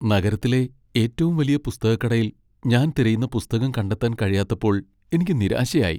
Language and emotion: Malayalam, sad